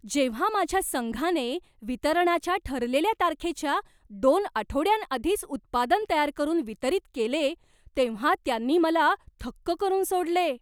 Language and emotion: Marathi, surprised